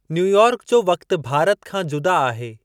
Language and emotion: Sindhi, neutral